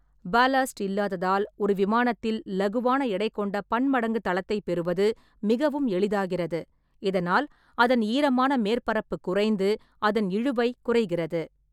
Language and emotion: Tamil, neutral